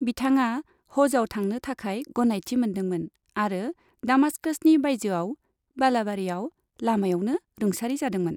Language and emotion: Bodo, neutral